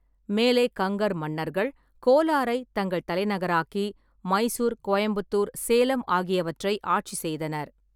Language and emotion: Tamil, neutral